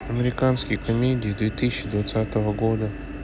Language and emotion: Russian, neutral